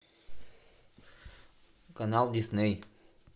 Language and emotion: Russian, neutral